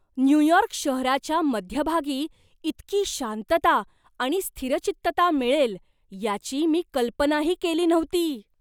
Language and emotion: Marathi, surprised